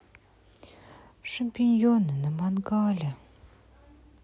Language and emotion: Russian, sad